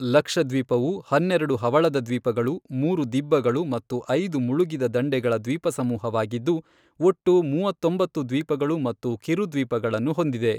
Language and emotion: Kannada, neutral